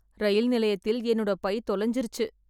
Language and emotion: Tamil, sad